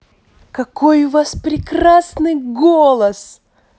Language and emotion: Russian, positive